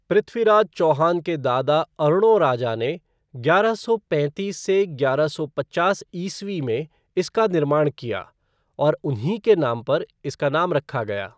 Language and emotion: Hindi, neutral